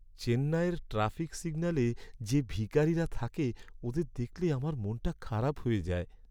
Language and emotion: Bengali, sad